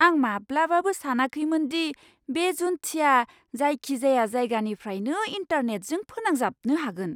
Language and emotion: Bodo, surprised